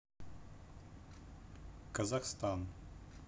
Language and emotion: Russian, neutral